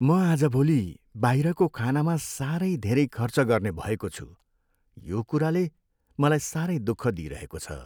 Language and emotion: Nepali, sad